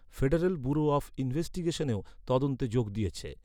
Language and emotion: Bengali, neutral